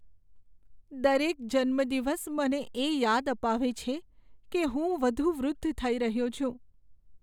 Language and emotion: Gujarati, sad